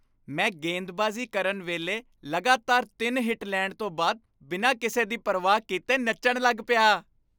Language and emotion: Punjabi, happy